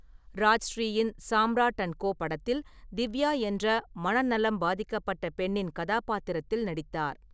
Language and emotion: Tamil, neutral